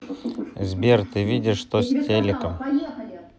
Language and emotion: Russian, neutral